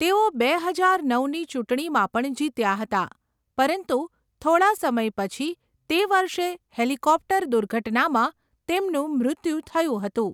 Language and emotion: Gujarati, neutral